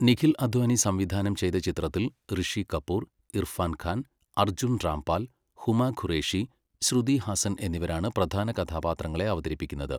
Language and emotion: Malayalam, neutral